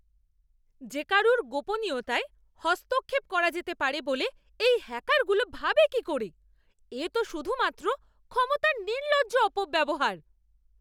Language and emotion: Bengali, angry